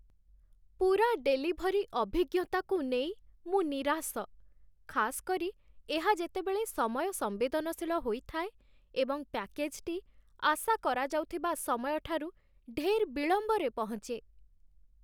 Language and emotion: Odia, sad